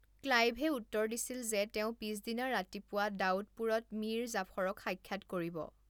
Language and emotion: Assamese, neutral